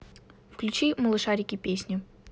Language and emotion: Russian, neutral